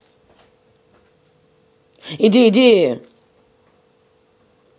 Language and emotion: Russian, angry